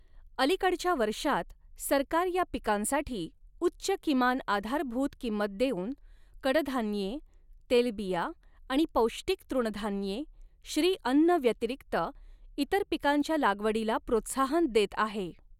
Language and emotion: Marathi, neutral